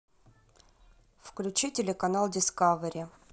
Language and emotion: Russian, neutral